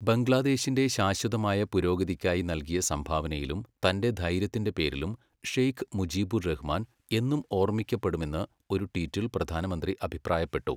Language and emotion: Malayalam, neutral